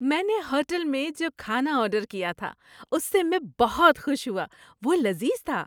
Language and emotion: Urdu, happy